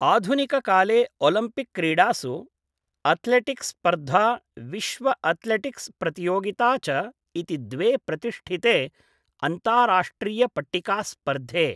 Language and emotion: Sanskrit, neutral